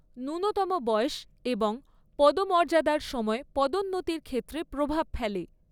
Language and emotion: Bengali, neutral